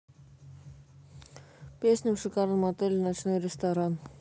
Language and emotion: Russian, neutral